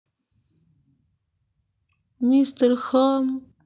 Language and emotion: Russian, sad